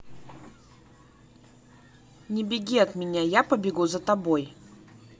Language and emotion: Russian, neutral